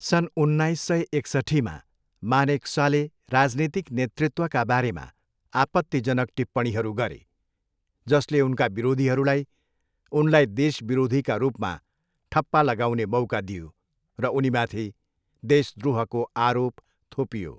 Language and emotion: Nepali, neutral